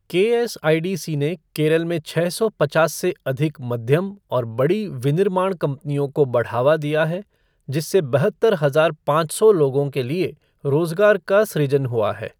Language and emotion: Hindi, neutral